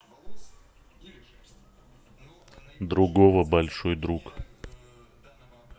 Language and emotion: Russian, neutral